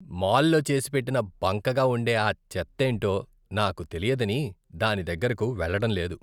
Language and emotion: Telugu, disgusted